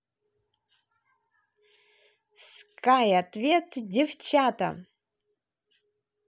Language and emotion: Russian, positive